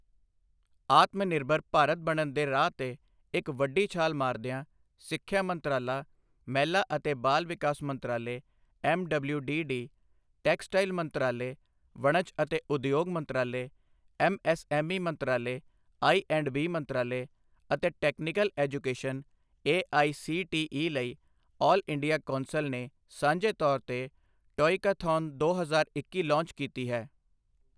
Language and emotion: Punjabi, neutral